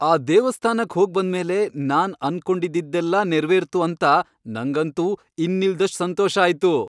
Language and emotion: Kannada, happy